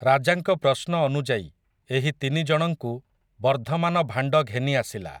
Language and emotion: Odia, neutral